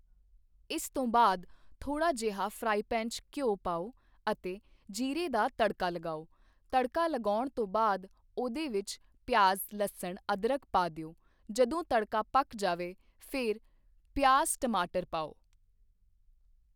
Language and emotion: Punjabi, neutral